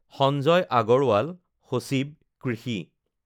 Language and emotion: Assamese, neutral